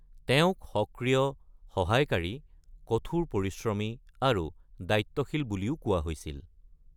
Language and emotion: Assamese, neutral